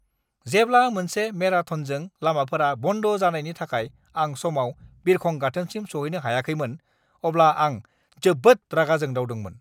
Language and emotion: Bodo, angry